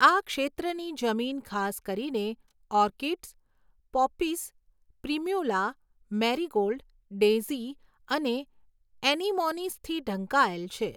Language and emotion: Gujarati, neutral